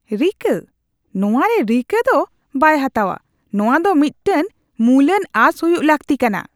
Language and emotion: Santali, disgusted